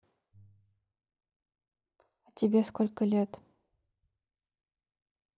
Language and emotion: Russian, neutral